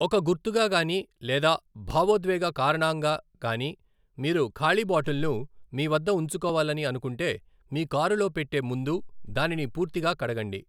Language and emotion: Telugu, neutral